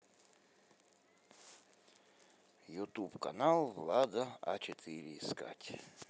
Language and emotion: Russian, neutral